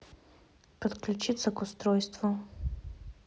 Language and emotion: Russian, neutral